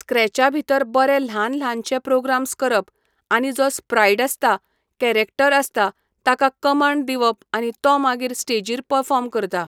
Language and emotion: Goan Konkani, neutral